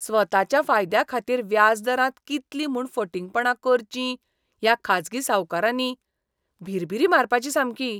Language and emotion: Goan Konkani, disgusted